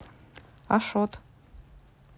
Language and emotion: Russian, neutral